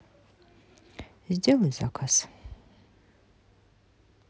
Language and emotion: Russian, neutral